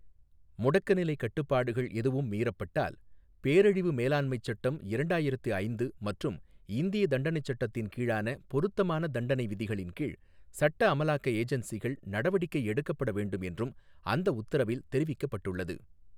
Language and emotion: Tamil, neutral